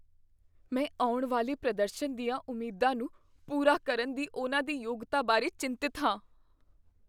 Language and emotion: Punjabi, fearful